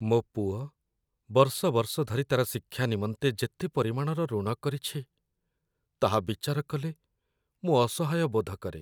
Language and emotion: Odia, sad